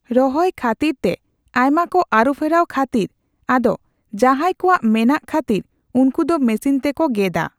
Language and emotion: Santali, neutral